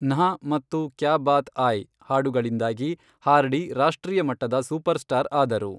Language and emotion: Kannada, neutral